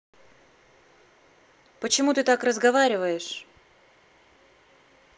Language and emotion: Russian, angry